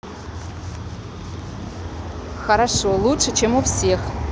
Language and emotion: Russian, neutral